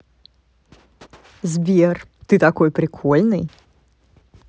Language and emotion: Russian, positive